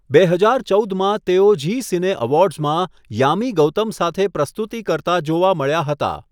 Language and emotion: Gujarati, neutral